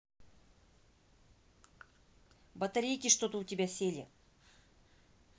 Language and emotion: Russian, neutral